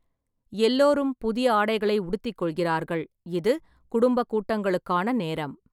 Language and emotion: Tamil, neutral